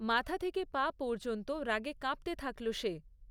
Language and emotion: Bengali, neutral